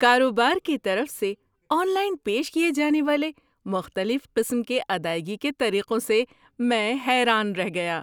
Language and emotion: Urdu, surprised